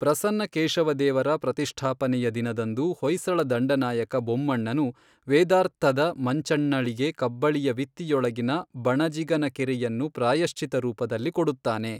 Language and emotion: Kannada, neutral